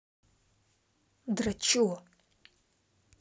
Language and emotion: Russian, angry